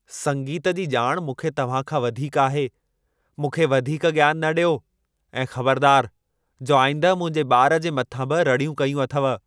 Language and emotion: Sindhi, angry